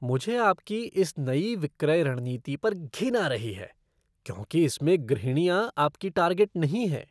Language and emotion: Hindi, disgusted